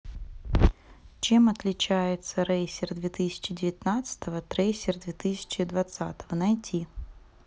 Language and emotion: Russian, neutral